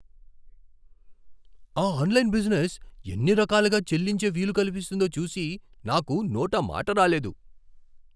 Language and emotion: Telugu, surprised